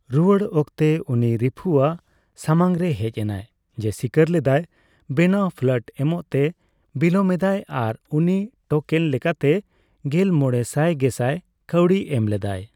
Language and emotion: Santali, neutral